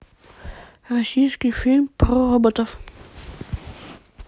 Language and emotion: Russian, neutral